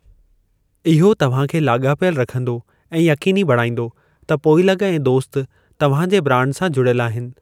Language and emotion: Sindhi, neutral